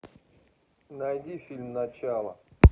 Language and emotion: Russian, neutral